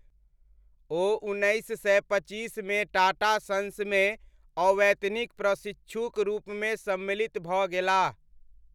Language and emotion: Maithili, neutral